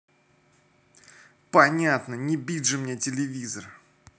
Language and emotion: Russian, angry